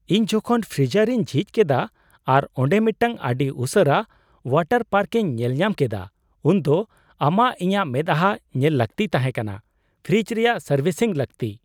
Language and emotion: Santali, surprised